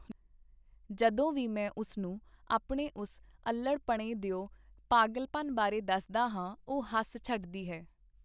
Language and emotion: Punjabi, neutral